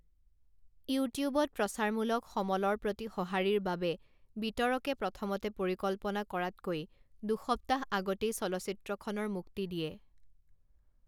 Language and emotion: Assamese, neutral